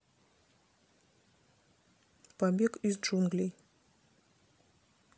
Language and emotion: Russian, neutral